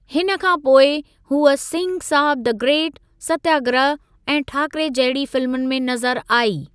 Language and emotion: Sindhi, neutral